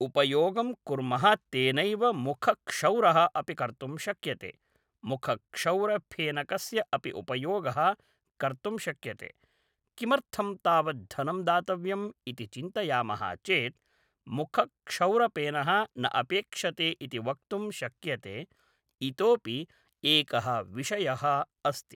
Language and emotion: Sanskrit, neutral